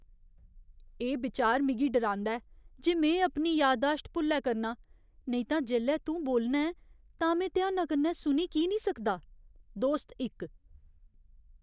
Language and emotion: Dogri, fearful